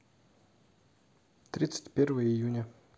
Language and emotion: Russian, neutral